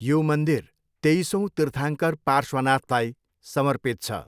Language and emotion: Nepali, neutral